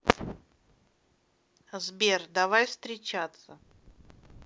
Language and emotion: Russian, neutral